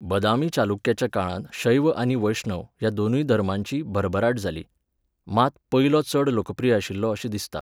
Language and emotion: Goan Konkani, neutral